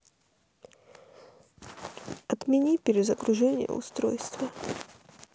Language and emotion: Russian, sad